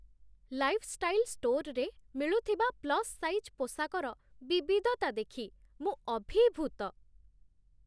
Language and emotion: Odia, surprised